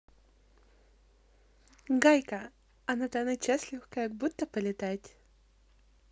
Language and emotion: Russian, positive